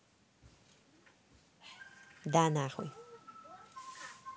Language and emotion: Russian, neutral